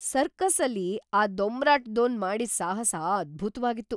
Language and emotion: Kannada, surprised